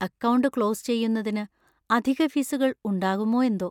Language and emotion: Malayalam, fearful